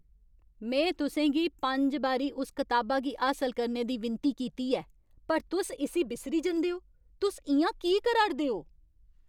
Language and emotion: Dogri, angry